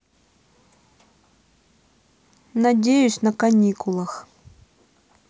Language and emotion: Russian, neutral